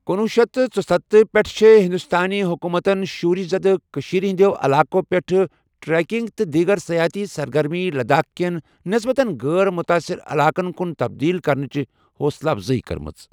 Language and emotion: Kashmiri, neutral